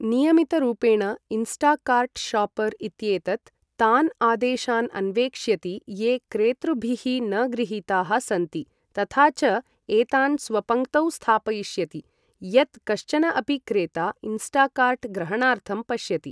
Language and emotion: Sanskrit, neutral